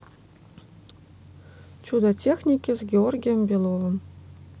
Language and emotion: Russian, neutral